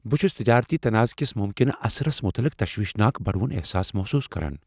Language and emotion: Kashmiri, fearful